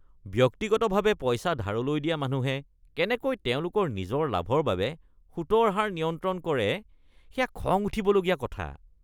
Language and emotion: Assamese, disgusted